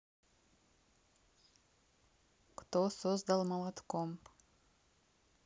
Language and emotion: Russian, neutral